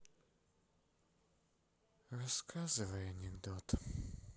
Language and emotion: Russian, sad